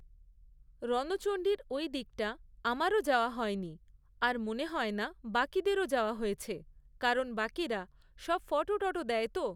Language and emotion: Bengali, neutral